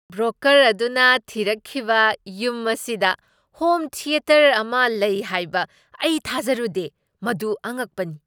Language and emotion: Manipuri, surprised